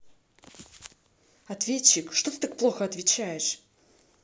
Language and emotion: Russian, angry